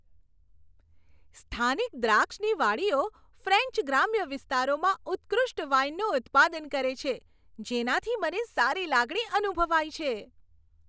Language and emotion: Gujarati, happy